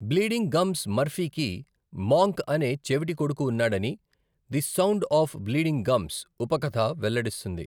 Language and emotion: Telugu, neutral